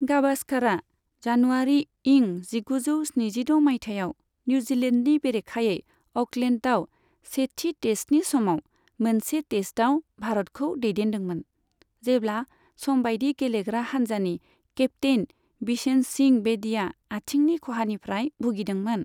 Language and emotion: Bodo, neutral